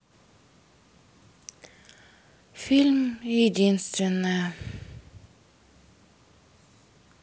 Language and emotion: Russian, sad